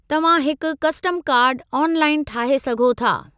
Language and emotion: Sindhi, neutral